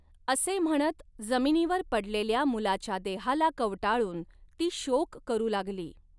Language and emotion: Marathi, neutral